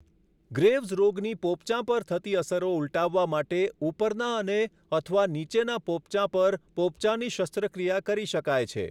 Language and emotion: Gujarati, neutral